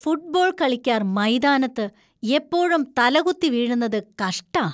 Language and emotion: Malayalam, disgusted